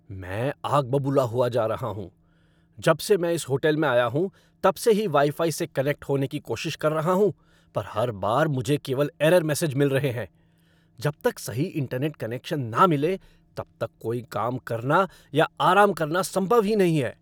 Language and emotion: Hindi, angry